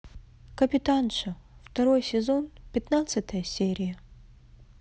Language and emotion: Russian, sad